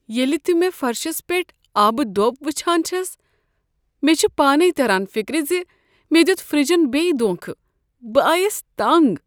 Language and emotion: Kashmiri, sad